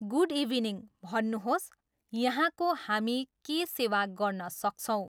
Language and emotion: Nepali, neutral